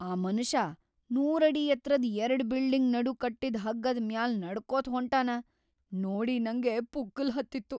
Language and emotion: Kannada, fearful